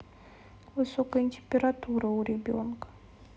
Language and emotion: Russian, sad